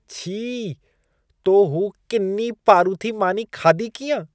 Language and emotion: Sindhi, disgusted